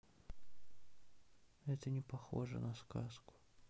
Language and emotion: Russian, sad